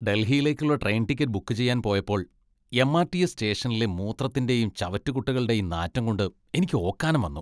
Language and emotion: Malayalam, disgusted